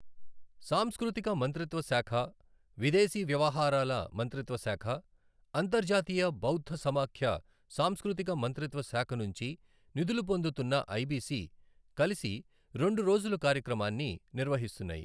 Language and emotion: Telugu, neutral